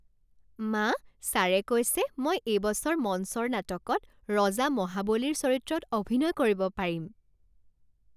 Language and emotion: Assamese, happy